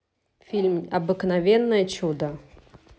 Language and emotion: Russian, neutral